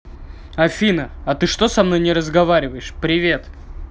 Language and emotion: Russian, angry